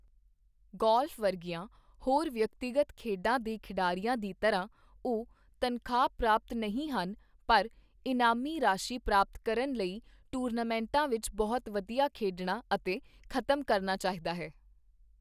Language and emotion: Punjabi, neutral